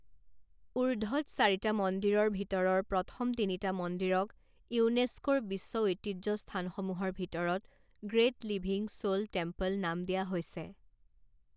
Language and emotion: Assamese, neutral